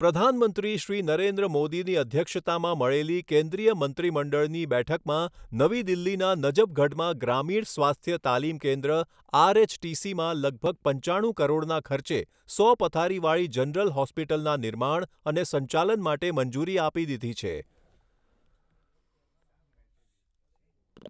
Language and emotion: Gujarati, neutral